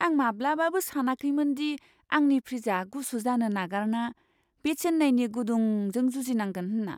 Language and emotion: Bodo, surprised